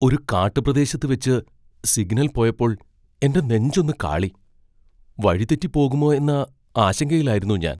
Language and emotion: Malayalam, fearful